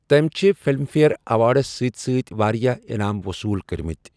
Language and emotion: Kashmiri, neutral